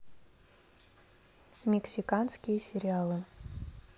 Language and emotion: Russian, neutral